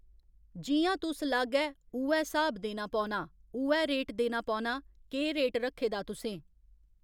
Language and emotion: Dogri, neutral